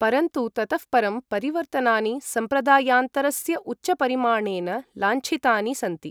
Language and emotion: Sanskrit, neutral